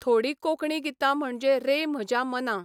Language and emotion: Goan Konkani, neutral